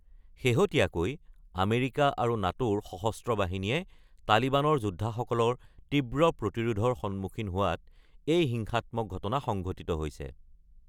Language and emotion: Assamese, neutral